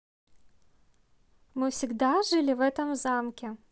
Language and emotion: Russian, positive